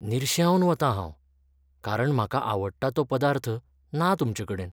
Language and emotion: Goan Konkani, sad